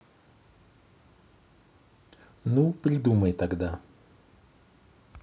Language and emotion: Russian, neutral